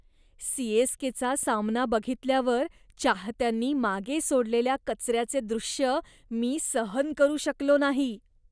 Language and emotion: Marathi, disgusted